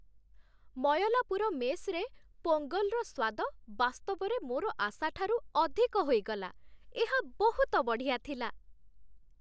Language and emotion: Odia, happy